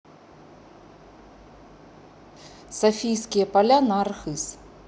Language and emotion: Russian, neutral